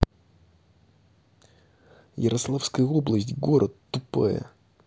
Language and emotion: Russian, angry